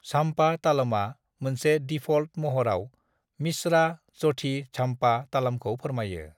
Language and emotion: Bodo, neutral